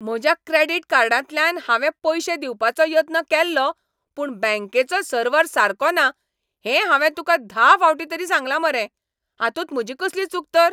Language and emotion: Goan Konkani, angry